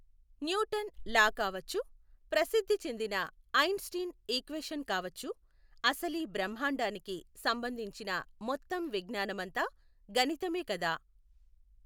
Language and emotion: Telugu, neutral